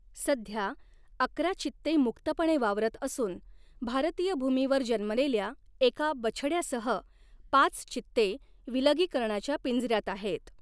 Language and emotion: Marathi, neutral